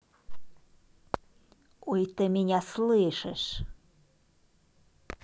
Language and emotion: Russian, angry